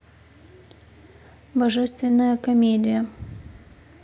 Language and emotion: Russian, neutral